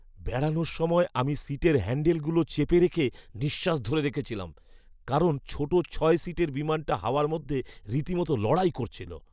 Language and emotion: Bengali, fearful